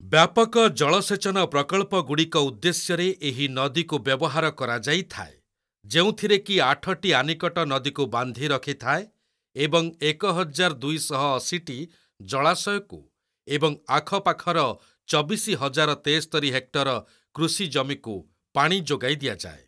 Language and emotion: Odia, neutral